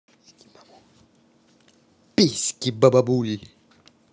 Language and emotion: Russian, positive